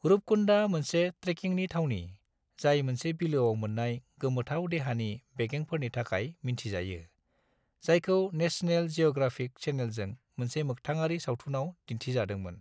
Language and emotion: Bodo, neutral